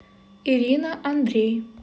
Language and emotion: Russian, neutral